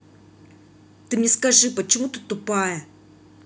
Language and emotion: Russian, angry